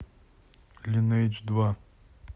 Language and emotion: Russian, neutral